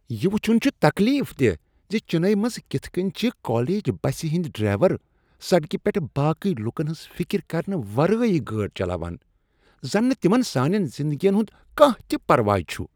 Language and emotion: Kashmiri, disgusted